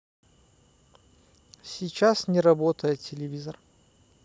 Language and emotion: Russian, neutral